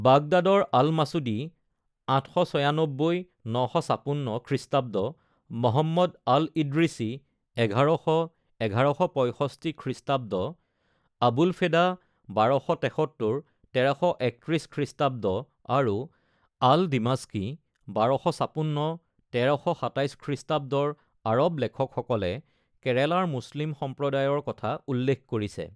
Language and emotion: Assamese, neutral